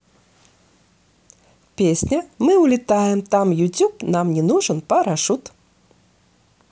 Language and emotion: Russian, positive